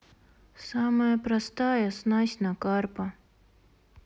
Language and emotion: Russian, sad